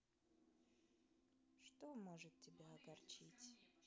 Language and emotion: Russian, neutral